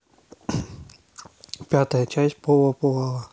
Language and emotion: Russian, neutral